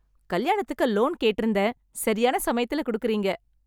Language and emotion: Tamil, happy